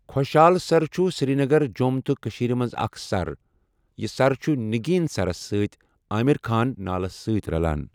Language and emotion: Kashmiri, neutral